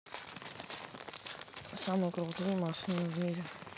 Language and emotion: Russian, neutral